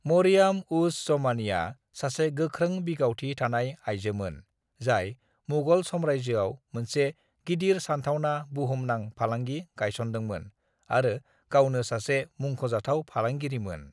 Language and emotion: Bodo, neutral